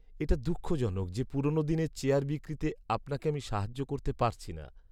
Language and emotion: Bengali, sad